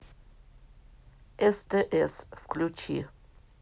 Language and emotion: Russian, neutral